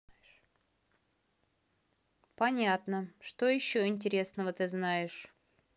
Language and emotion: Russian, angry